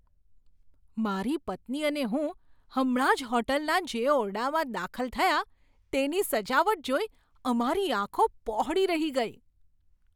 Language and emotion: Gujarati, surprised